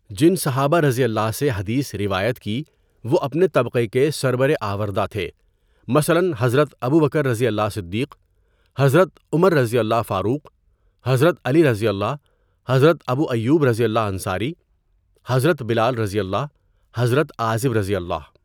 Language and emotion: Urdu, neutral